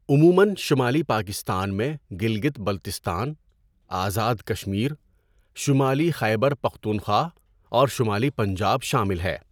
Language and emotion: Urdu, neutral